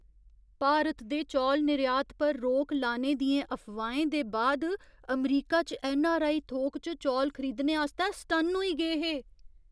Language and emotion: Dogri, surprised